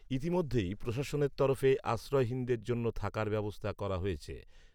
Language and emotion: Bengali, neutral